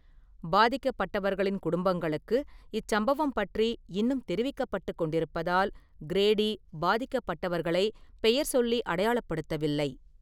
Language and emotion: Tamil, neutral